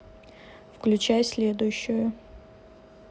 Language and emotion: Russian, neutral